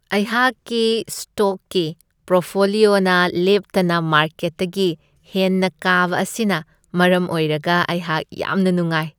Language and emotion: Manipuri, happy